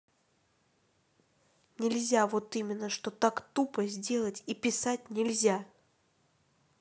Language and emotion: Russian, angry